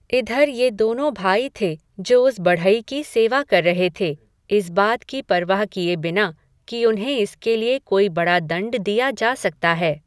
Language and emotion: Hindi, neutral